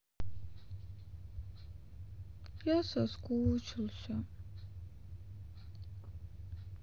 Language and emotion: Russian, sad